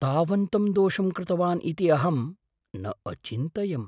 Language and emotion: Sanskrit, surprised